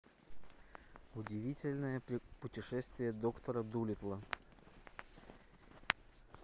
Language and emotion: Russian, neutral